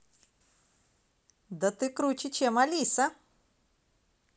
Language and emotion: Russian, positive